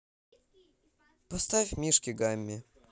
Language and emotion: Russian, neutral